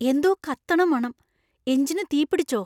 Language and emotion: Malayalam, fearful